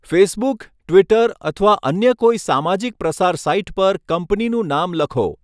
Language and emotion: Gujarati, neutral